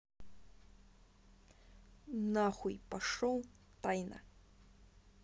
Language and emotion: Russian, angry